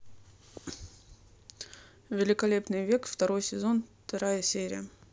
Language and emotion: Russian, neutral